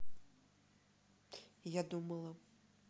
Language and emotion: Russian, neutral